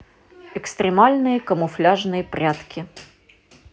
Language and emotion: Russian, neutral